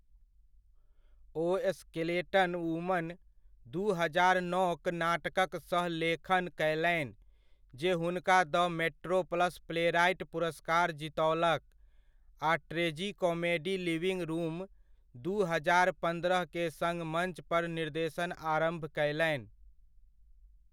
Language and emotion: Maithili, neutral